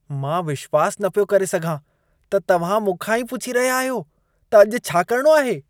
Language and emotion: Sindhi, disgusted